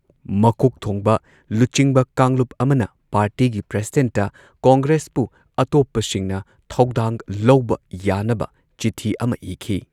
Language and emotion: Manipuri, neutral